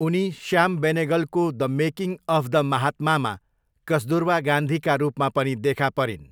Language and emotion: Nepali, neutral